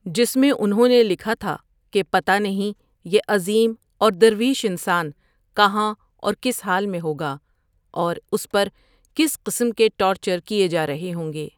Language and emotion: Urdu, neutral